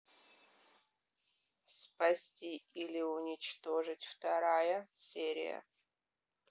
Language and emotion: Russian, neutral